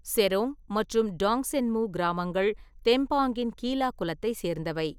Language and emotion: Tamil, neutral